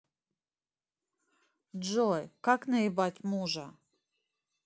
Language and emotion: Russian, neutral